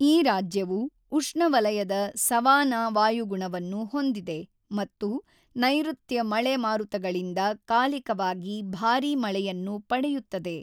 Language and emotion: Kannada, neutral